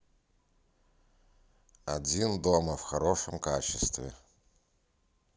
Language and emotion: Russian, neutral